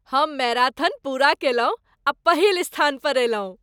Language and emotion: Maithili, happy